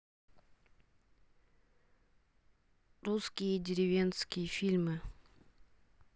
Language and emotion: Russian, neutral